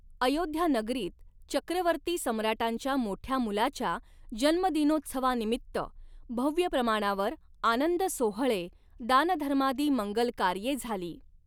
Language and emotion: Marathi, neutral